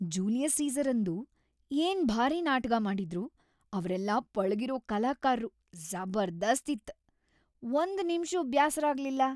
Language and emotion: Kannada, happy